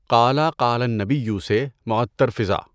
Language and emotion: Urdu, neutral